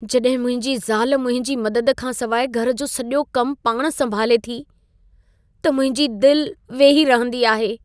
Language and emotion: Sindhi, sad